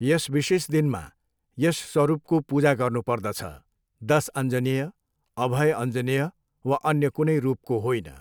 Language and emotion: Nepali, neutral